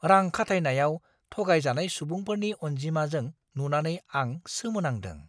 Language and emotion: Bodo, surprised